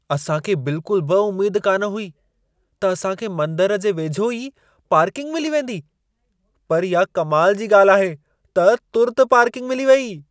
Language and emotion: Sindhi, surprised